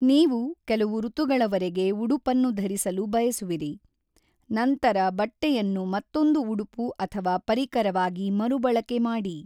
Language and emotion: Kannada, neutral